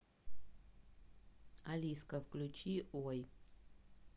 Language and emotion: Russian, neutral